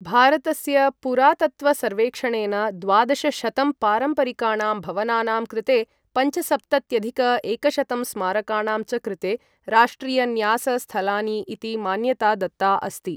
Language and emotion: Sanskrit, neutral